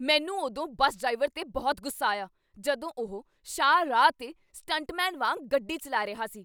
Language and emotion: Punjabi, angry